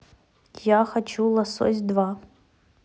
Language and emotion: Russian, neutral